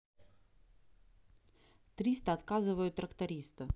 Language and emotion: Russian, neutral